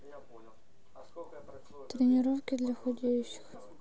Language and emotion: Russian, sad